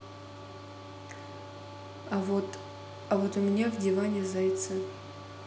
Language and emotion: Russian, neutral